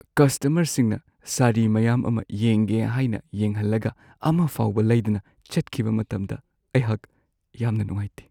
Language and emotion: Manipuri, sad